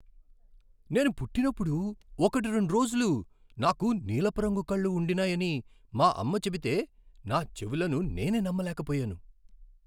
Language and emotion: Telugu, surprised